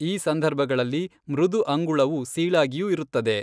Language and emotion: Kannada, neutral